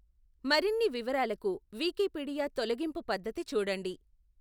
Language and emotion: Telugu, neutral